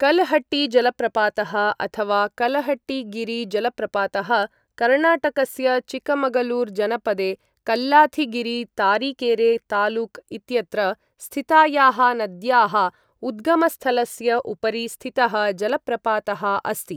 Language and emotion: Sanskrit, neutral